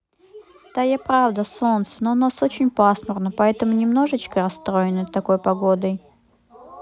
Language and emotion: Russian, sad